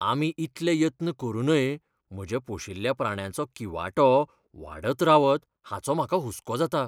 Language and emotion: Goan Konkani, fearful